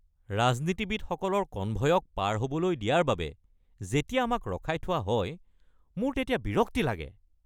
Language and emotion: Assamese, angry